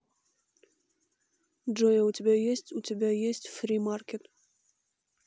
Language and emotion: Russian, neutral